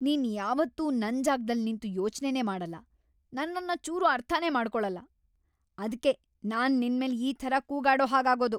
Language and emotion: Kannada, angry